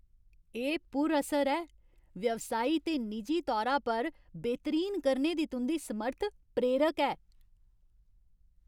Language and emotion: Dogri, happy